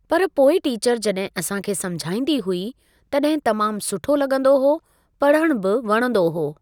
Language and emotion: Sindhi, neutral